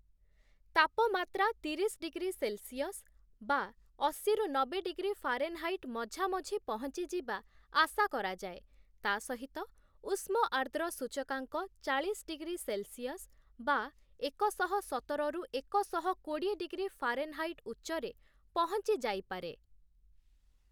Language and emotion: Odia, neutral